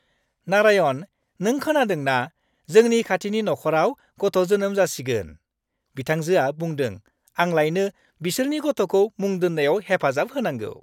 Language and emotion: Bodo, happy